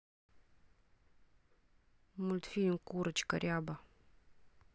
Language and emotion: Russian, neutral